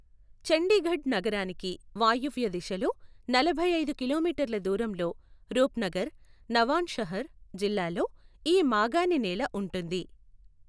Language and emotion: Telugu, neutral